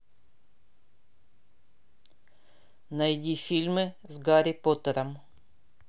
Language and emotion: Russian, neutral